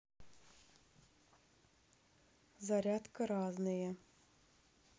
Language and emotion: Russian, neutral